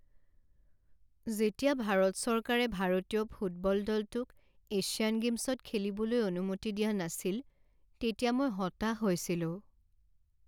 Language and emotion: Assamese, sad